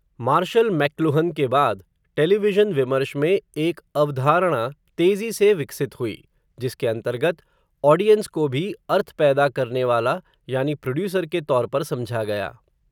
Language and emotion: Hindi, neutral